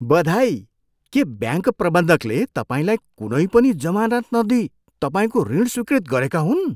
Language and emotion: Nepali, surprised